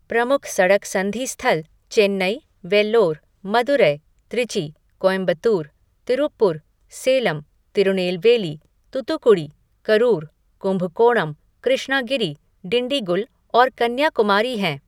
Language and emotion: Hindi, neutral